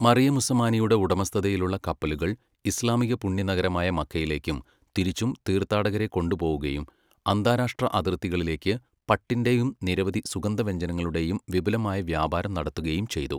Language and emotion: Malayalam, neutral